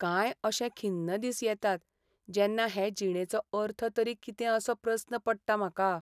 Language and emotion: Goan Konkani, sad